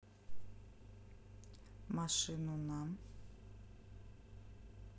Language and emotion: Russian, neutral